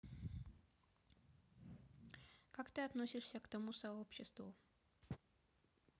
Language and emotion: Russian, neutral